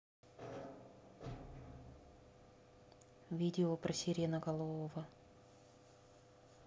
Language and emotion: Russian, neutral